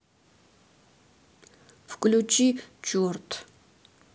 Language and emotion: Russian, sad